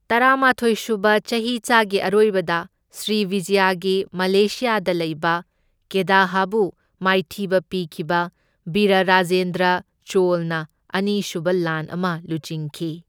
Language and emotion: Manipuri, neutral